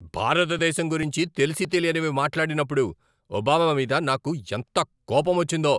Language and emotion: Telugu, angry